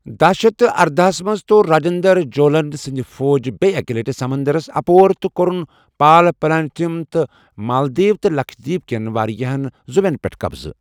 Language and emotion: Kashmiri, neutral